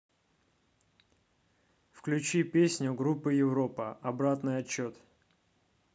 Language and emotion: Russian, neutral